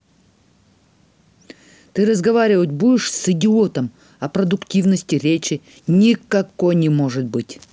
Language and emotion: Russian, angry